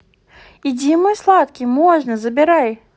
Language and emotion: Russian, positive